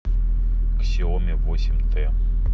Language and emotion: Russian, neutral